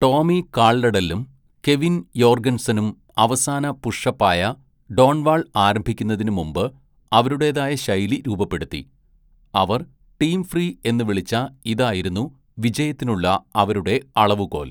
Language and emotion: Malayalam, neutral